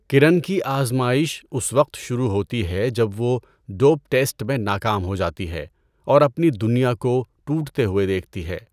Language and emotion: Urdu, neutral